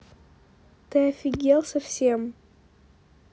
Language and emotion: Russian, angry